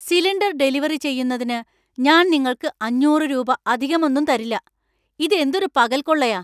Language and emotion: Malayalam, angry